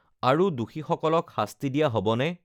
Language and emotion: Assamese, neutral